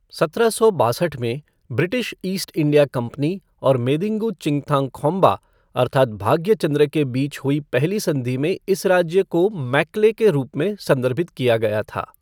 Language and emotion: Hindi, neutral